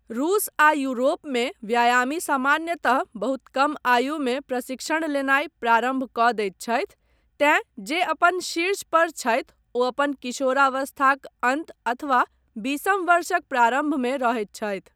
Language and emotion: Maithili, neutral